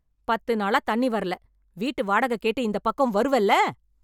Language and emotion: Tamil, angry